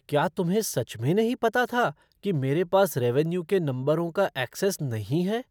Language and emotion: Hindi, surprised